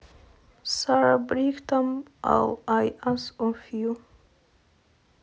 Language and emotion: Russian, neutral